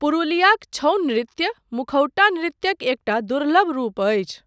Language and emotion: Maithili, neutral